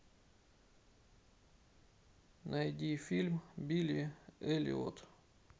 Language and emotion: Russian, sad